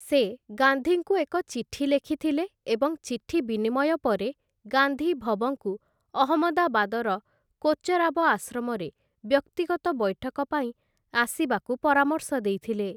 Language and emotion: Odia, neutral